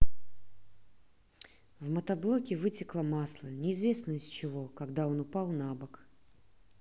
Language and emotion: Russian, neutral